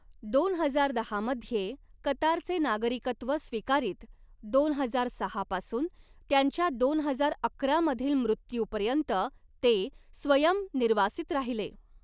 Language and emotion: Marathi, neutral